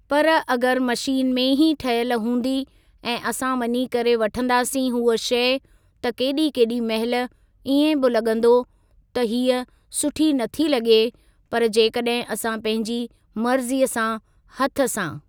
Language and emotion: Sindhi, neutral